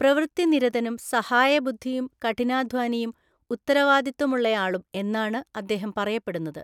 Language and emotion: Malayalam, neutral